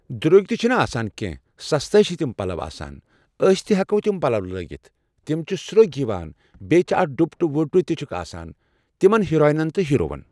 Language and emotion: Kashmiri, neutral